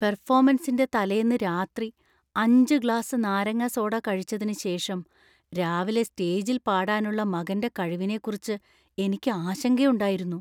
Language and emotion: Malayalam, fearful